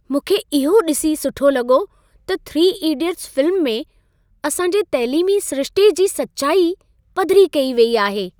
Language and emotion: Sindhi, happy